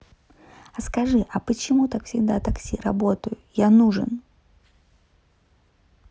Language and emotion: Russian, neutral